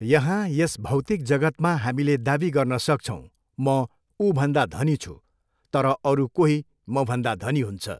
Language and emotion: Nepali, neutral